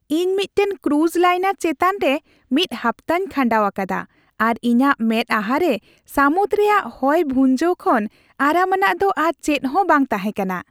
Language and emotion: Santali, happy